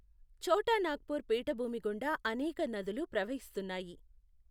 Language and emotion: Telugu, neutral